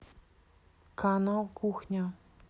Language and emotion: Russian, neutral